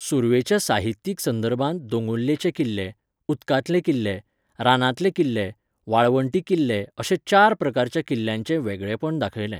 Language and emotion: Goan Konkani, neutral